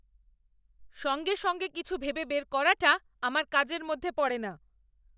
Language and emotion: Bengali, angry